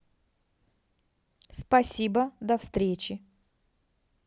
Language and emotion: Russian, neutral